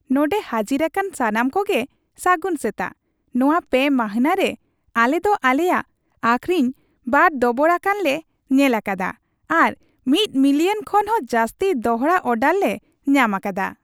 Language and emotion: Santali, happy